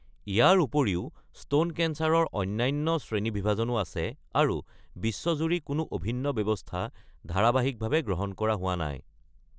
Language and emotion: Assamese, neutral